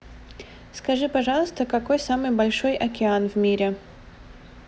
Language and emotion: Russian, neutral